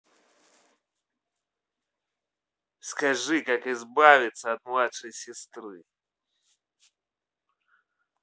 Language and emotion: Russian, angry